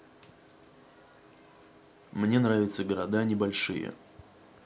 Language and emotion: Russian, neutral